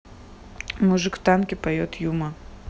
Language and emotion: Russian, neutral